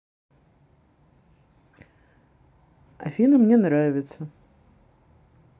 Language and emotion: Russian, neutral